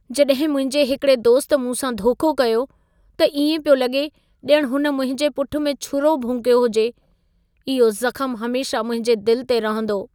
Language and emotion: Sindhi, sad